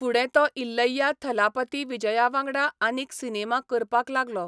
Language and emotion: Goan Konkani, neutral